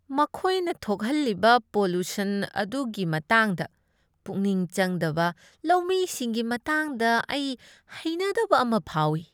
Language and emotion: Manipuri, disgusted